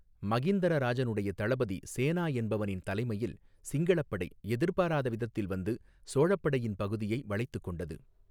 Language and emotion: Tamil, neutral